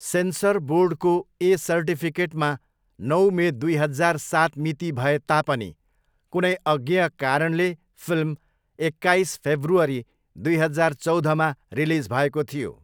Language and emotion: Nepali, neutral